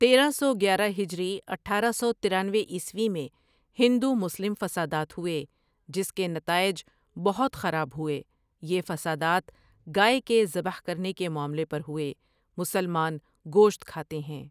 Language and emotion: Urdu, neutral